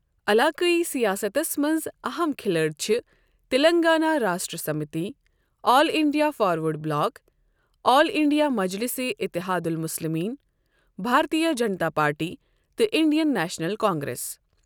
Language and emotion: Kashmiri, neutral